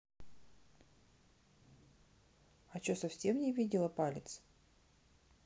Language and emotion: Russian, neutral